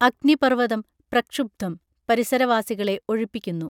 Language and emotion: Malayalam, neutral